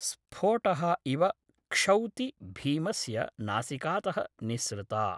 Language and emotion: Sanskrit, neutral